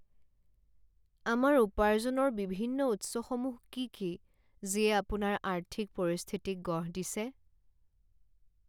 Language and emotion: Assamese, sad